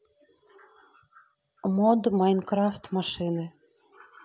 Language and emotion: Russian, neutral